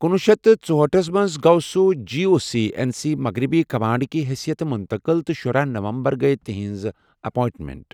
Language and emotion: Kashmiri, neutral